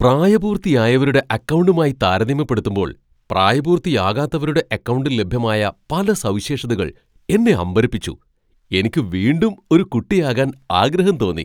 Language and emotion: Malayalam, surprised